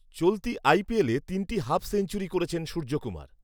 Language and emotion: Bengali, neutral